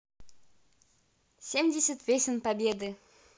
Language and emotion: Russian, positive